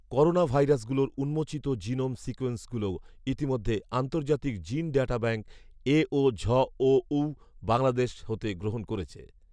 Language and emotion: Bengali, neutral